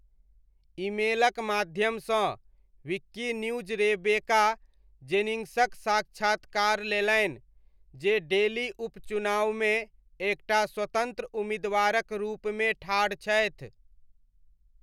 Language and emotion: Maithili, neutral